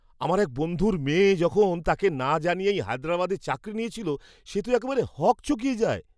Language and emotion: Bengali, surprised